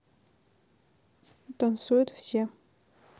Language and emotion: Russian, neutral